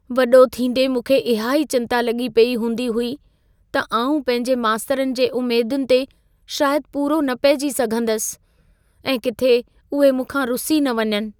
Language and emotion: Sindhi, fearful